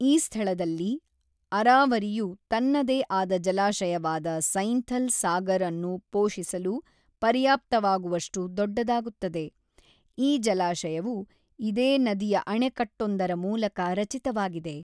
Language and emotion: Kannada, neutral